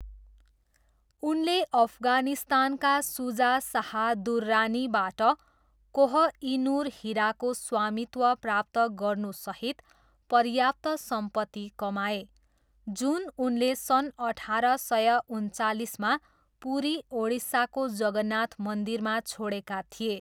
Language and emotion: Nepali, neutral